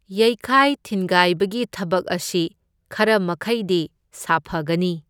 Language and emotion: Manipuri, neutral